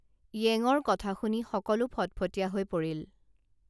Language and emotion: Assamese, neutral